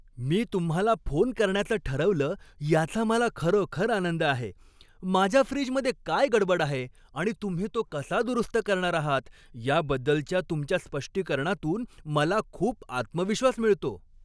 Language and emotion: Marathi, happy